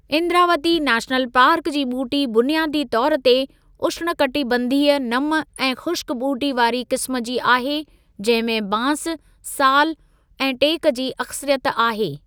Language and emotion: Sindhi, neutral